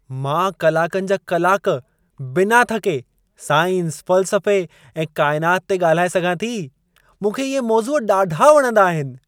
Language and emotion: Sindhi, happy